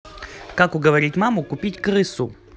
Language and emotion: Russian, neutral